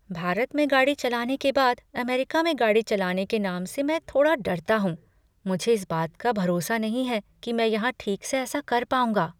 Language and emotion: Hindi, fearful